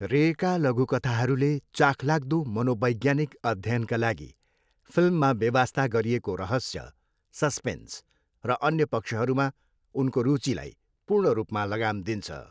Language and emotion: Nepali, neutral